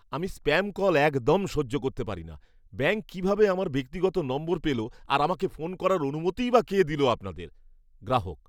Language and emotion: Bengali, angry